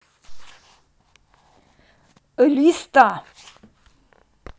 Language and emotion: Russian, angry